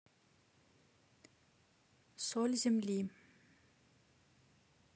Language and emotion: Russian, neutral